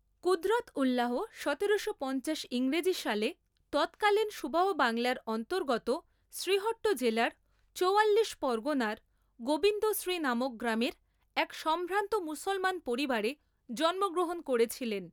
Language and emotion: Bengali, neutral